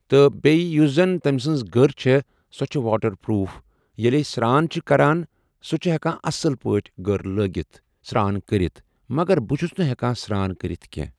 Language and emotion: Kashmiri, neutral